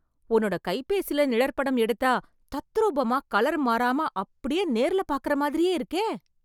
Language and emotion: Tamil, surprised